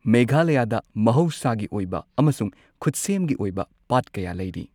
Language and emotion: Manipuri, neutral